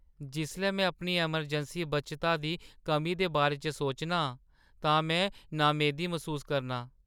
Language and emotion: Dogri, sad